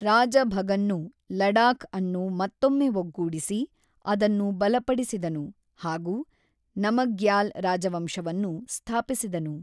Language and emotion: Kannada, neutral